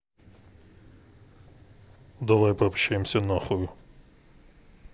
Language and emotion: Russian, neutral